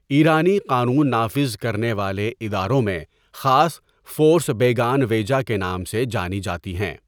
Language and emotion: Urdu, neutral